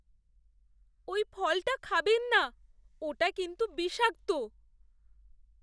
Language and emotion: Bengali, fearful